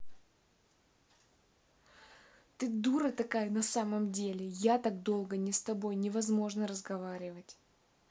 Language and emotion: Russian, angry